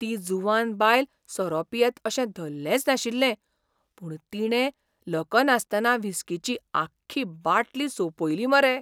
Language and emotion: Goan Konkani, surprised